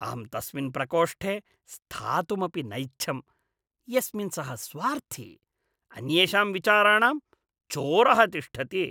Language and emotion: Sanskrit, disgusted